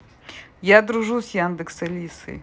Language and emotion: Russian, positive